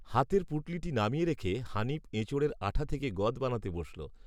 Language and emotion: Bengali, neutral